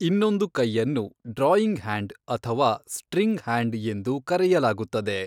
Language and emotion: Kannada, neutral